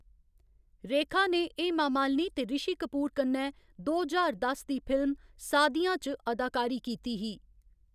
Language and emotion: Dogri, neutral